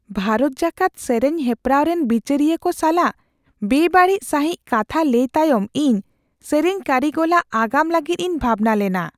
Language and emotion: Santali, fearful